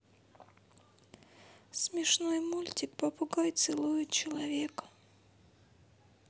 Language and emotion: Russian, sad